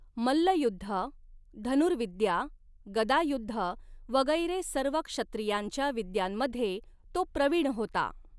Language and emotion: Marathi, neutral